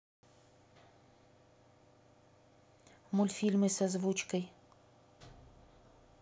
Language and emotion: Russian, neutral